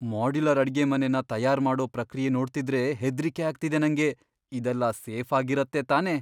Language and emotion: Kannada, fearful